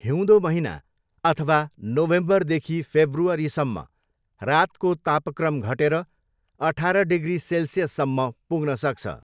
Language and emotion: Nepali, neutral